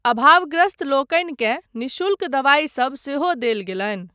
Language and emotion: Maithili, neutral